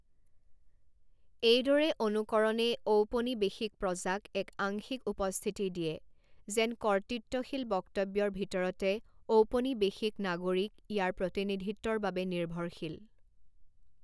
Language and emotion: Assamese, neutral